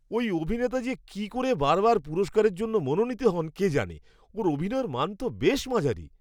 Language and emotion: Bengali, disgusted